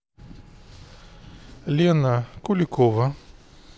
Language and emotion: Russian, neutral